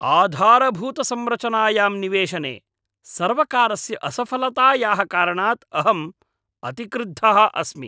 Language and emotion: Sanskrit, angry